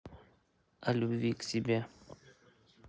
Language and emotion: Russian, neutral